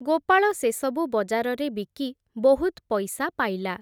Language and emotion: Odia, neutral